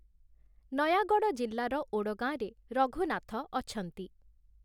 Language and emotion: Odia, neutral